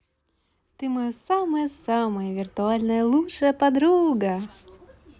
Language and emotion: Russian, positive